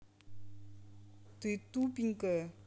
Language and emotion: Russian, angry